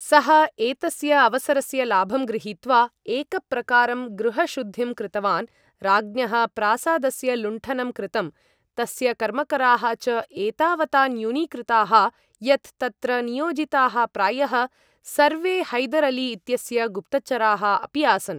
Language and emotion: Sanskrit, neutral